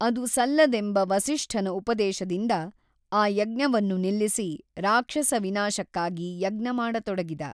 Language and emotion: Kannada, neutral